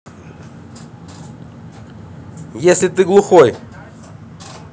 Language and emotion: Russian, angry